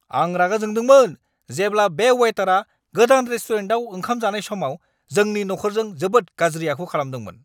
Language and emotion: Bodo, angry